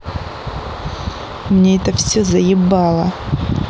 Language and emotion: Russian, angry